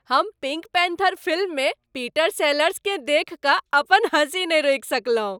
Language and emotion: Maithili, happy